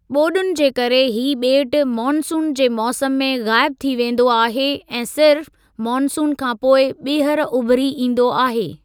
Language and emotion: Sindhi, neutral